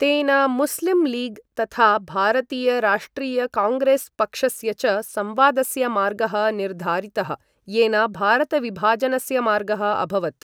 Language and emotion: Sanskrit, neutral